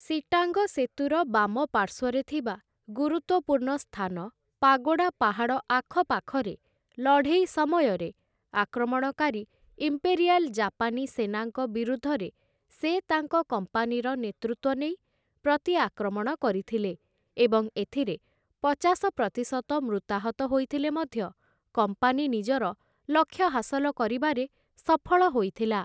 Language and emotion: Odia, neutral